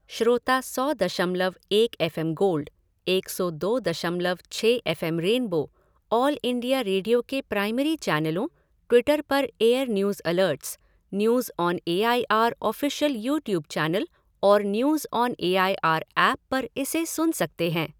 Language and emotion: Hindi, neutral